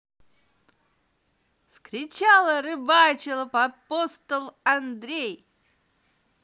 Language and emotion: Russian, positive